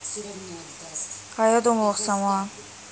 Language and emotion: Russian, neutral